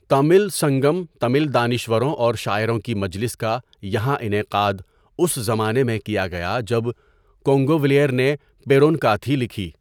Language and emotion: Urdu, neutral